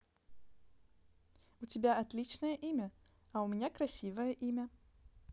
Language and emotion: Russian, positive